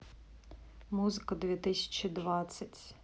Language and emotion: Russian, neutral